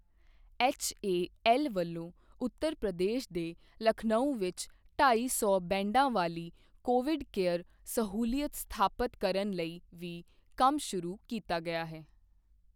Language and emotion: Punjabi, neutral